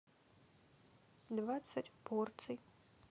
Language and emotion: Russian, neutral